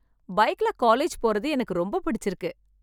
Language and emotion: Tamil, happy